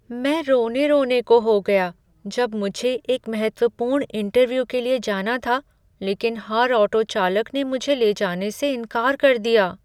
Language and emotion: Hindi, sad